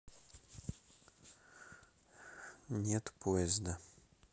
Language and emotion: Russian, neutral